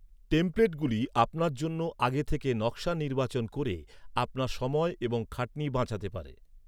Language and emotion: Bengali, neutral